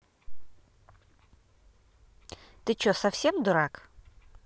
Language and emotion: Russian, angry